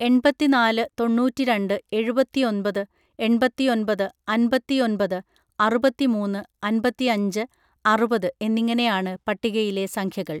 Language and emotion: Malayalam, neutral